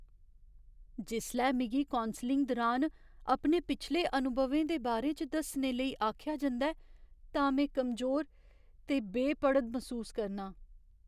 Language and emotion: Dogri, fearful